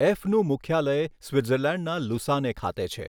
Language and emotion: Gujarati, neutral